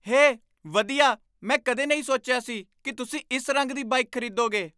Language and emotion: Punjabi, surprised